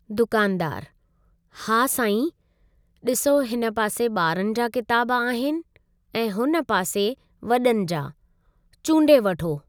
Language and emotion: Sindhi, neutral